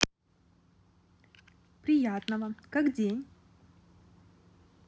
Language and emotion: Russian, positive